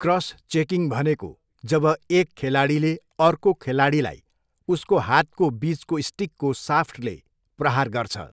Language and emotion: Nepali, neutral